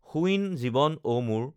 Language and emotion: Assamese, neutral